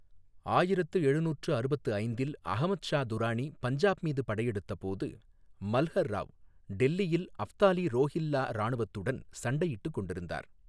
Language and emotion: Tamil, neutral